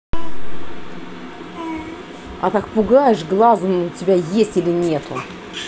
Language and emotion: Russian, angry